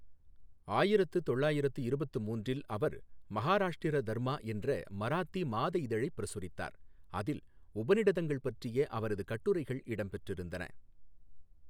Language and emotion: Tamil, neutral